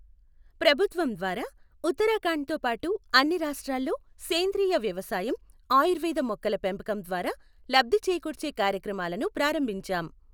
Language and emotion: Telugu, neutral